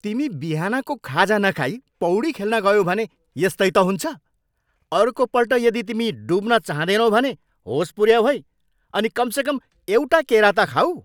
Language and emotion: Nepali, angry